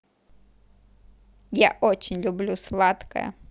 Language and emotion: Russian, positive